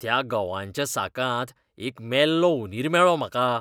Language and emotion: Goan Konkani, disgusted